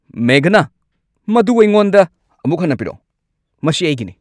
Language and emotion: Manipuri, angry